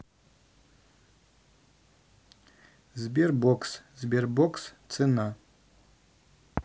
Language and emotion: Russian, neutral